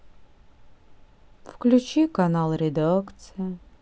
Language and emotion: Russian, sad